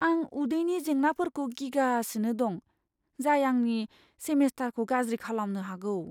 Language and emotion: Bodo, fearful